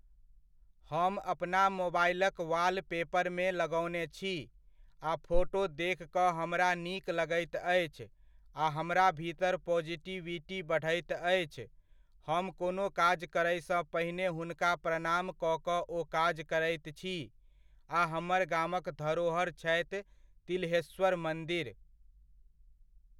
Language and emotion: Maithili, neutral